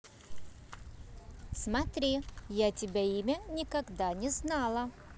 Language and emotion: Russian, neutral